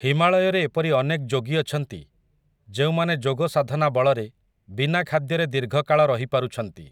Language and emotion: Odia, neutral